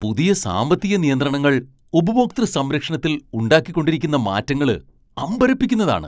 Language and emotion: Malayalam, surprised